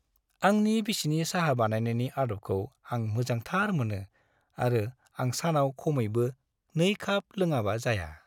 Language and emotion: Bodo, happy